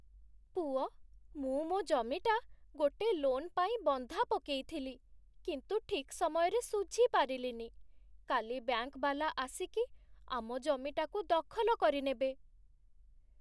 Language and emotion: Odia, sad